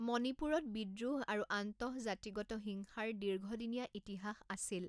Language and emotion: Assamese, neutral